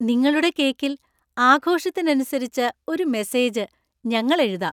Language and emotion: Malayalam, happy